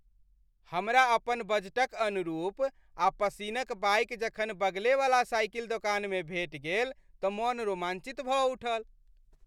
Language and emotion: Maithili, happy